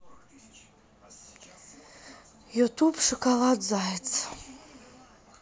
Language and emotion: Russian, sad